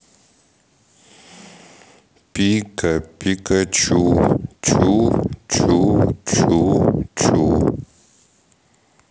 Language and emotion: Russian, sad